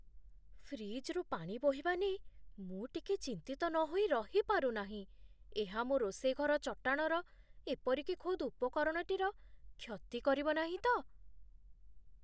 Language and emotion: Odia, fearful